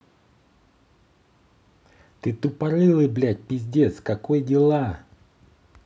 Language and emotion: Russian, angry